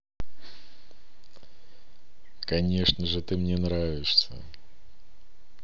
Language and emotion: Russian, positive